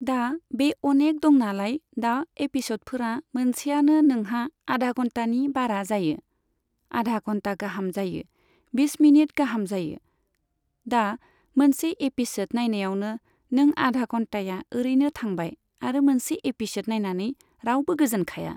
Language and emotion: Bodo, neutral